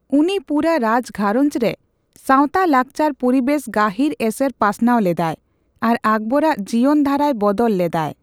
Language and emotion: Santali, neutral